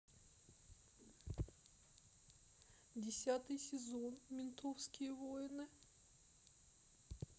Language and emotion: Russian, sad